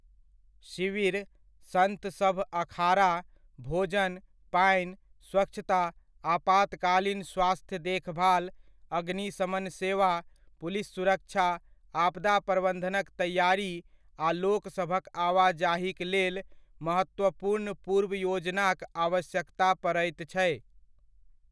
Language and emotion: Maithili, neutral